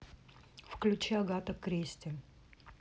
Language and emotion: Russian, neutral